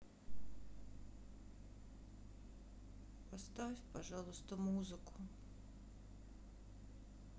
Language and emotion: Russian, sad